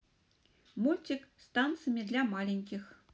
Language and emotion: Russian, positive